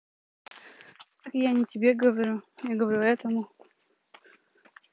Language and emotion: Russian, neutral